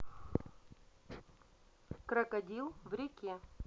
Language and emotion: Russian, neutral